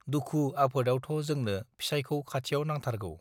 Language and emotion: Bodo, neutral